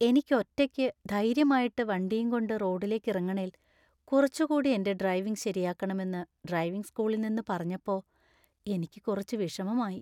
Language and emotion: Malayalam, sad